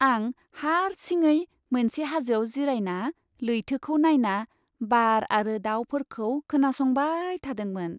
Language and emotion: Bodo, happy